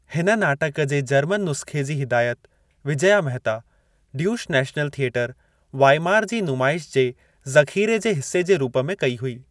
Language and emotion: Sindhi, neutral